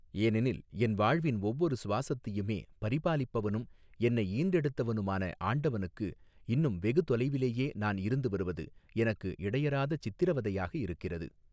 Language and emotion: Tamil, neutral